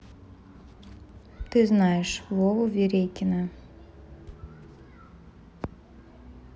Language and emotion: Russian, neutral